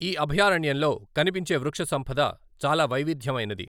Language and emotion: Telugu, neutral